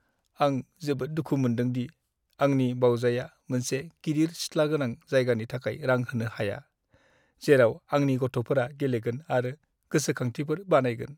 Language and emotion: Bodo, sad